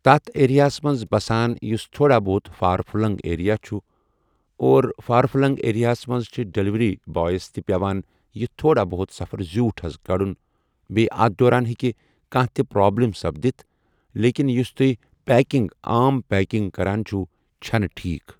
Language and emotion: Kashmiri, neutral